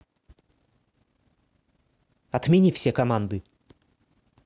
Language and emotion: Russian, angry